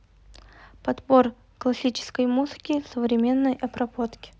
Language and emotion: Russian, neutral